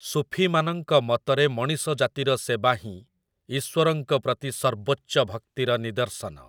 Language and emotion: Odia, neutral